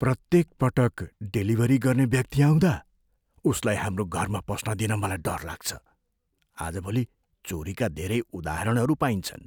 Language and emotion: Nepali, fearful